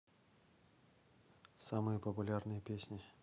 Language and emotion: Russian, neutral